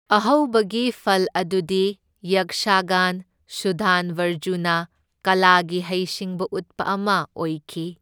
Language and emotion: Manipuri, neutral